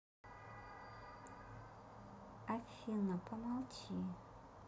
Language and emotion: Russian, neutral